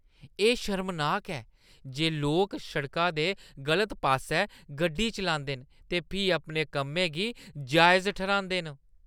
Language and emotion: Dogri, disgusted